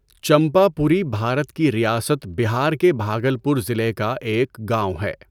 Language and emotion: Urdu, neutral